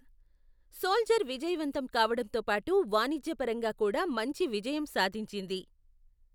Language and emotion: Telugu, neutral